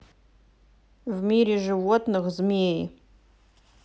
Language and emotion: Russian, neutral